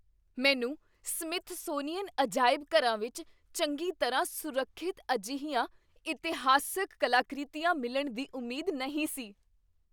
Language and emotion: Punjabi, surprised